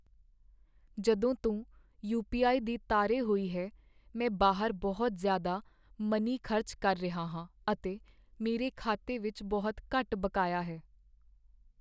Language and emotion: Punjabi, sad